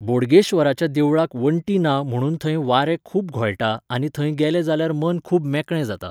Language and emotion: Goan Konkani, neutral